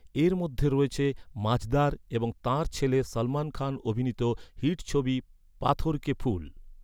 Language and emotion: Bengali, neutral